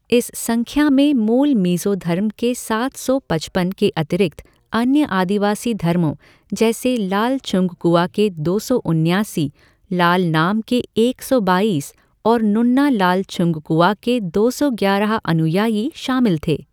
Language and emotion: Hindi, neutral